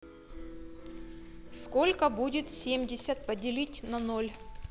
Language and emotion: Russian, neutral